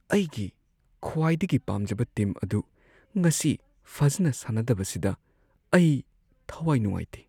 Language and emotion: Manipuri, sad